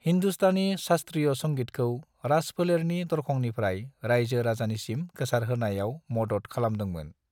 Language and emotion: Bodo, neutral